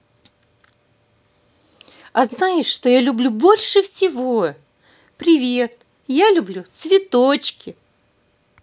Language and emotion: Russian, positive